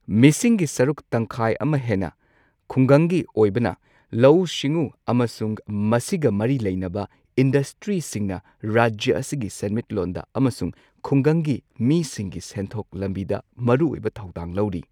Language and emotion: Manipuri, neutral